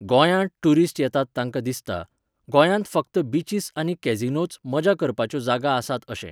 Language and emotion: Goan Konkani, neutral